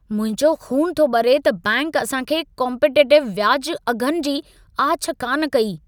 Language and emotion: Sindhi, angry